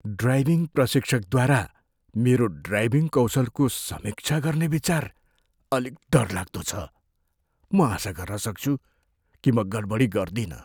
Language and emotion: Nepali, fearful